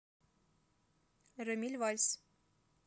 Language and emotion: Russian, neutral